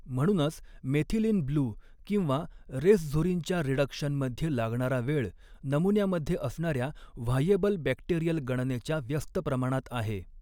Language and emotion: Marathi, neutral